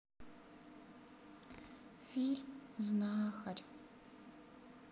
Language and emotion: Russian, sad